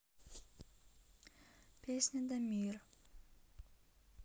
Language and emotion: Russian, neutral